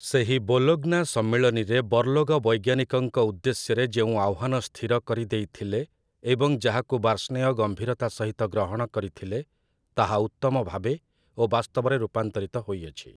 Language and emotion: Odia, neutral